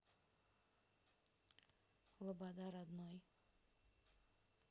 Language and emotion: Russian, neutral